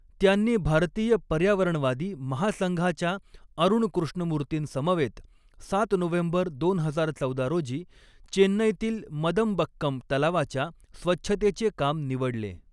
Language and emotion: Marathi, neutral